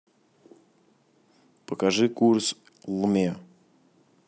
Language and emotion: Russian, neutral